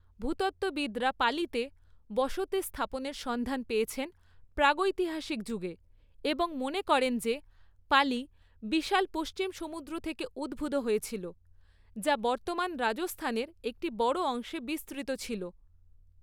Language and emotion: Bengali, neutral